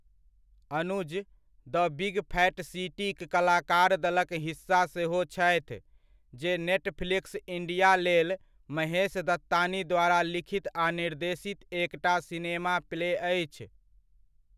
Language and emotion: Maithili, neutral